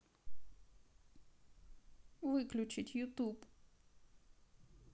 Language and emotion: Russian, sad